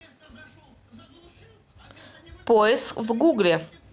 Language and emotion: Russian, neutral